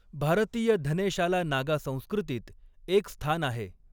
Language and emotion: Marathi, neutral